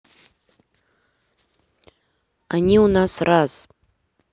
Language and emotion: Russian, neutral